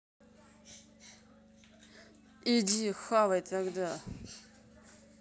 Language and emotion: Russian, angry